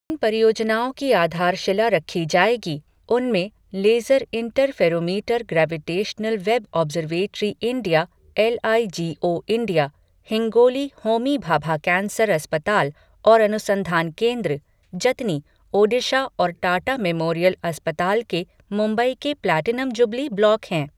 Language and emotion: Hindi, neutral